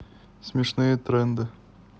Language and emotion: Russian, positive